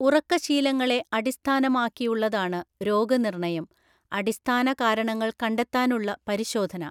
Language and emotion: Malayalam, neutral